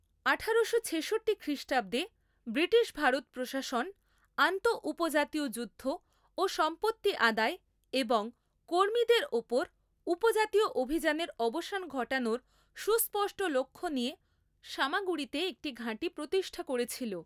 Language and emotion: Bengali, neutral